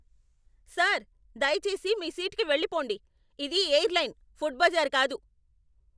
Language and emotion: Telugu, angry